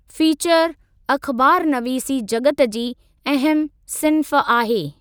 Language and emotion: Sindhi, neutral